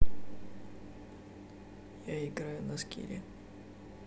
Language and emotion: Russian, neutral